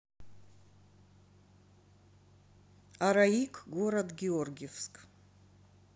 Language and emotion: Russian, neutral